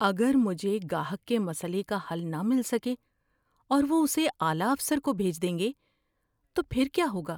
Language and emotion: Urdu, fearful